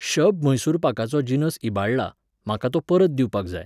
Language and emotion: Goan Konkani, neutral